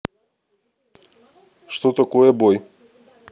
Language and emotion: Russian, neutral